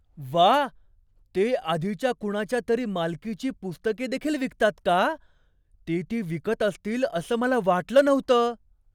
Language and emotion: Marathi, surprised